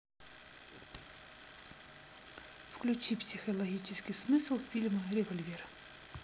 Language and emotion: Russian, neutral